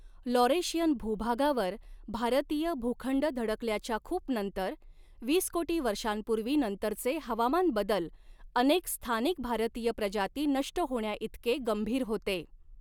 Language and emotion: Marathi, neutral